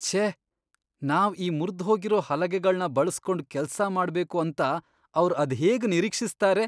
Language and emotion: Kannada, disgusted